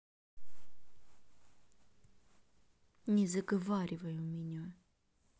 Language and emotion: Russian, angry